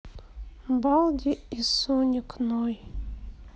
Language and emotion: Russian, sad